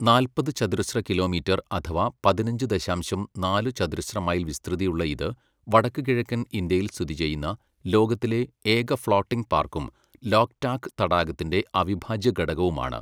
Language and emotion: Malayalam, neutral